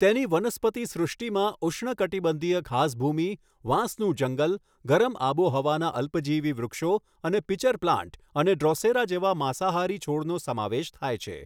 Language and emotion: Gujarati, neutral